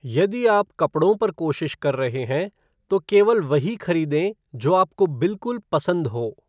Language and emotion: Hindi, neutral